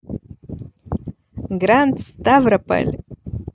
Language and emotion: Russian, positive